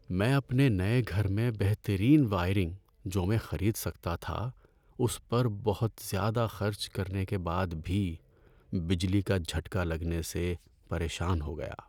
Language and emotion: Urdu, sad